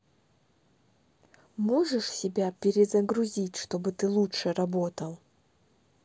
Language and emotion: Russian, neutral